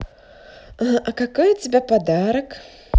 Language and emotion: Russian, positive